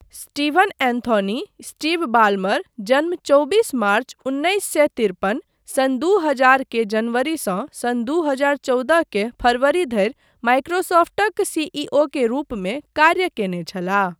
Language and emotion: Maithili, neutral